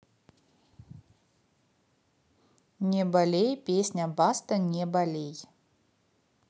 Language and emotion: Russian, positive